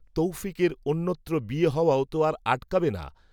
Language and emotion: Bengali, neutral